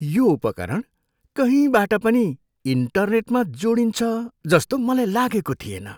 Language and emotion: Nepali, surprised